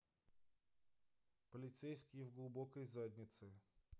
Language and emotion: Russian, neutral